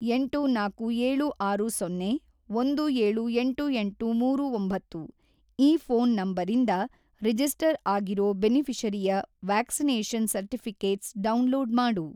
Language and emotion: Kannada, neutral